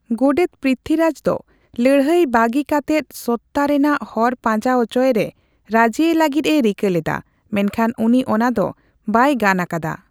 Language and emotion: Santali, neutral